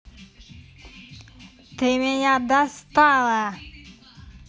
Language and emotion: Russian, angry